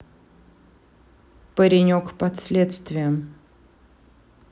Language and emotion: Russian, neutral